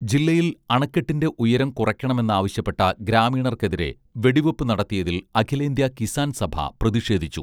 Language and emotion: Malayalam, neutral